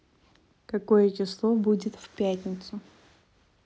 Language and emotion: Russian, neutral